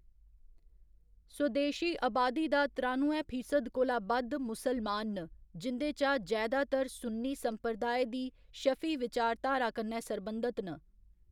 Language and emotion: Dogri, neutral